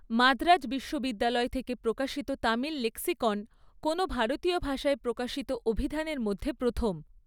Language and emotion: Bengali, neutral